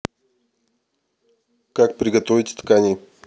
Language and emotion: Russian, neutral